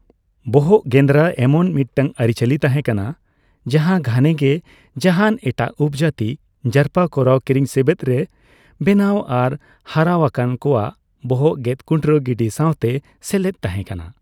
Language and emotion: Santali, neutral